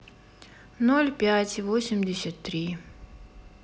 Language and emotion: Russian, sad